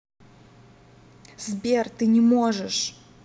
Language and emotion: Russian, angry